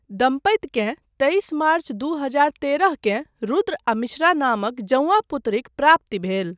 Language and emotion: Maithili, neutral